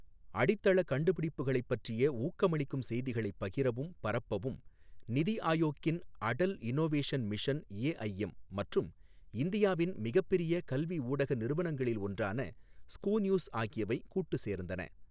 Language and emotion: Tamil, neutral